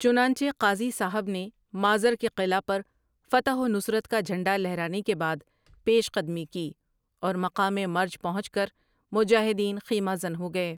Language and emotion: Urdu, neutral